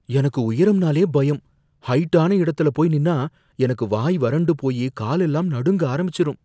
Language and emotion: Tamil, fearful